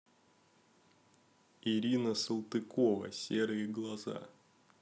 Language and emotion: Russian, neutral